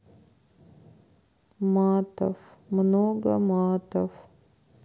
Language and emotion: Russian, sad